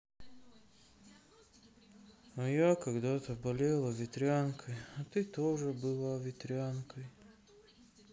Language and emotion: Russian, sad